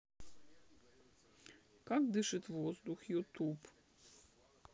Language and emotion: Russian, neutral